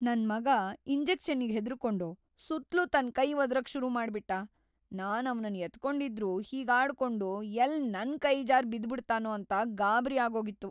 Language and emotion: Kannada, fearful